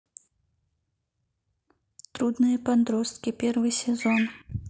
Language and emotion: Russian, neutral